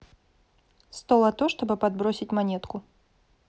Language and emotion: Russian, neutral